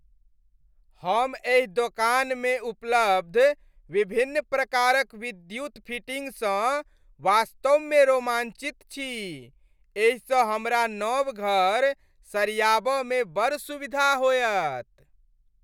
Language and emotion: Maithili, happy